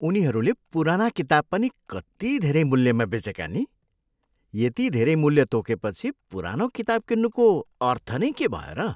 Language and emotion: Nepali, disgusted